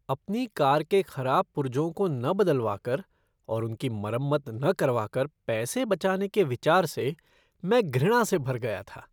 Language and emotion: Hindi, disgusted